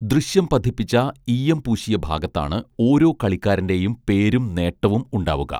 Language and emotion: Malayalam, neutral